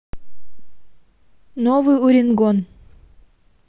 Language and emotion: Russian, neutral